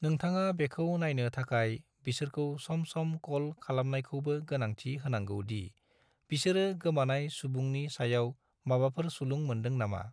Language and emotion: Bodo, neutral